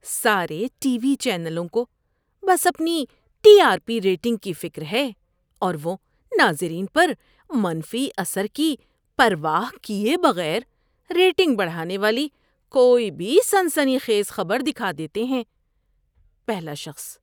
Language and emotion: Urdu, disgusted